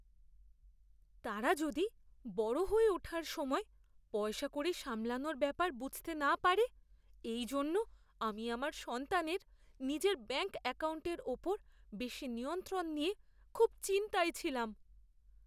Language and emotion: Bengali, fearful